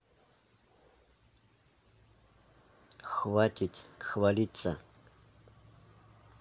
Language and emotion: Russian, neutral